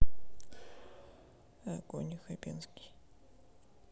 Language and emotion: Russian, neutral